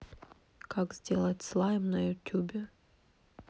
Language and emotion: Russian, neutral